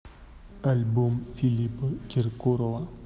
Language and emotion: Russian, neutral